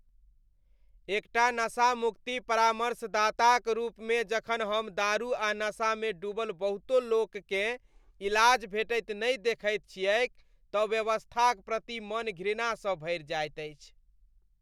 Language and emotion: Maithili, disgusted